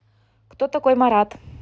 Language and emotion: Russian, neutral